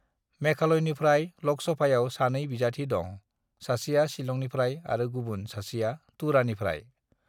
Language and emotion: Bodo, neutral